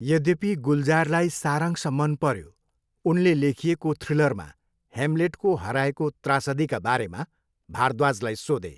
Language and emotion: Nepali, neutral